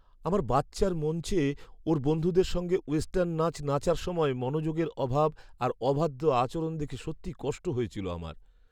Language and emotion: Bengali, sad